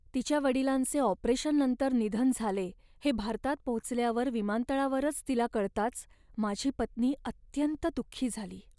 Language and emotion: Marathi, sad